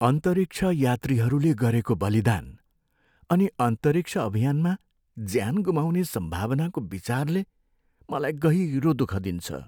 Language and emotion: Nepali, sad